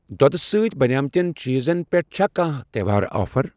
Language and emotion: Kashmiri, neutral